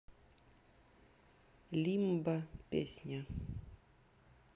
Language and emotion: Russian, neutral